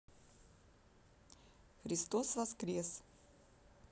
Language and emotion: Russian, neutral